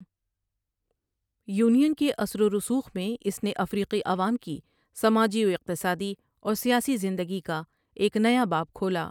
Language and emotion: Urdu, neutral